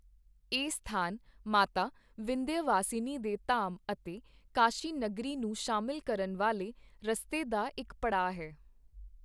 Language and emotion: Punjabi, neutral